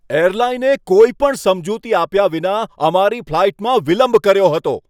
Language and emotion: Gujarati, angry